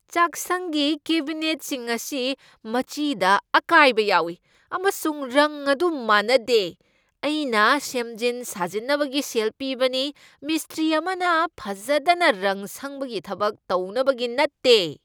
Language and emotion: Manipuri, angry